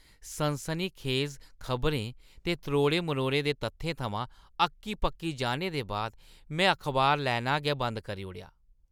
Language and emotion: Dogri, disgusted